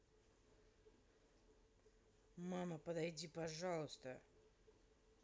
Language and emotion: Russian, angry